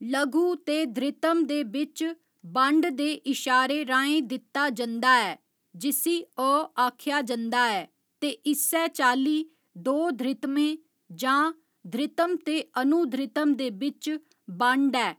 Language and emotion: Dogri, neutral